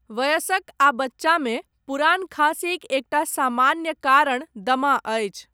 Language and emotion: Maithili, neutral